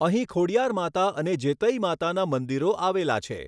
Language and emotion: Gujarati, neutral